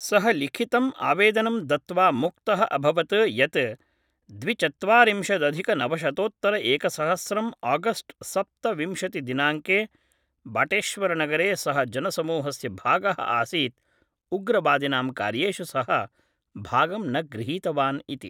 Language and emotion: Sanskrit, neutral